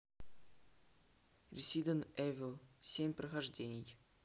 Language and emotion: Russian, neutral